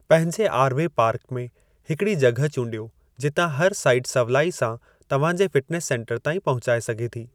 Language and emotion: Sindhi, neutral